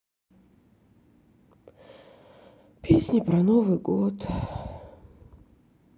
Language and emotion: Russian, sad